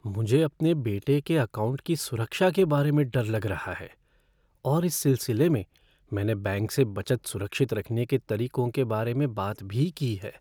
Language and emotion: Hindi, fearful